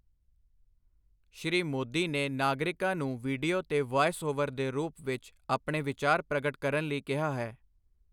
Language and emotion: Punjabi, neutral